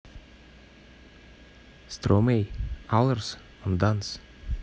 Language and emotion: Russian, neutral